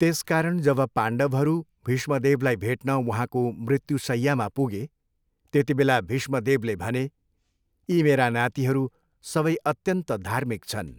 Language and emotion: Nepali, neutral